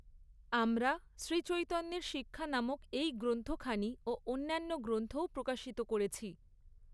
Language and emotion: Bengali, neutral